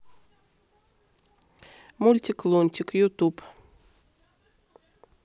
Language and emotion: Russian, neutral